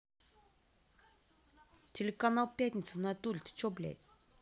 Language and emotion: Russian, angry